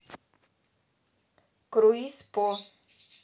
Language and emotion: Russian, neutral